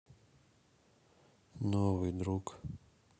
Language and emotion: Russian, neutral